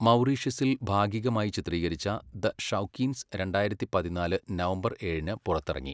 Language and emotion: Malayalam, neutral